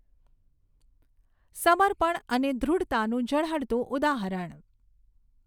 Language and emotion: Gujarati, neutral